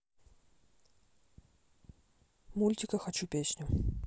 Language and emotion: Russian, neutral